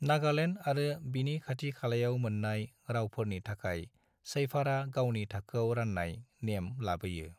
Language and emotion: Bodo, neutral